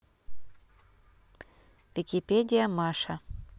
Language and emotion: Russian, neutral